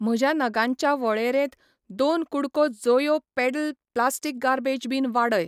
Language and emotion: Goan Konkani, neutral